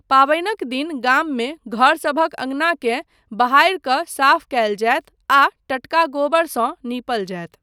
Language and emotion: Maithili, neutral